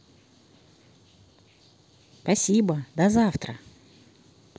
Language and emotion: Russian, positive